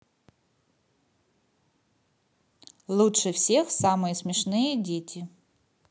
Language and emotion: Russian, positive